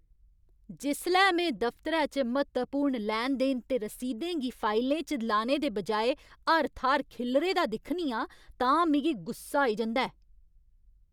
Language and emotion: Dogri, angry